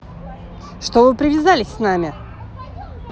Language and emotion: Russian, angry